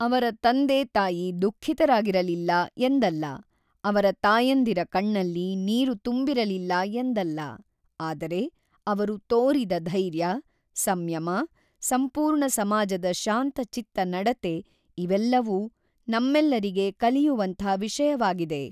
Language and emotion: Kannada, neutral